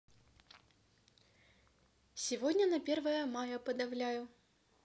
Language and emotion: Russian, neutral